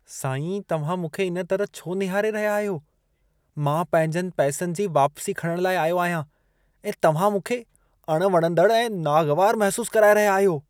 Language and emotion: Sindhi, disgusted